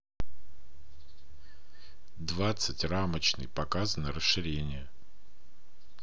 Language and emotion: Russian, neutral